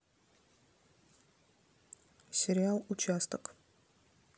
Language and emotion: Russian, neutral